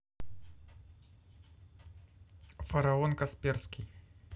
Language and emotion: Russian, neutral